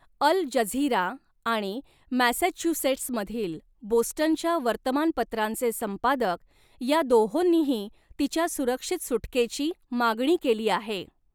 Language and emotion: Marathi, neutral